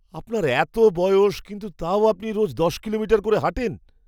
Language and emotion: Bengali, surprised